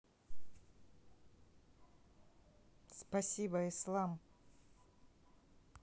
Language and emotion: Russian, neutral